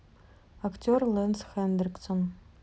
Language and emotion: Russian, neutral